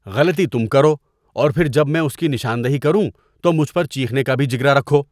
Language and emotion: Urdu, disgusted